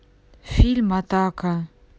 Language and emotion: Russian, neutral